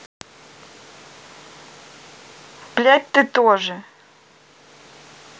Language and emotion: Russian, neutral